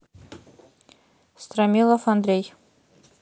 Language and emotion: Russian, neutral